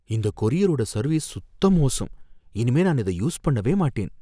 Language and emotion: Tamil, fearful